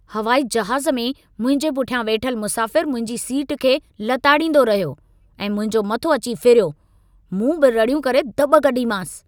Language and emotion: Sindhi, angry